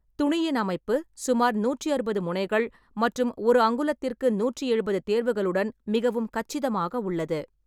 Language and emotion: Tamil, neutral